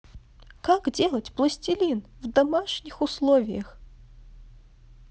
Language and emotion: Russian, neutral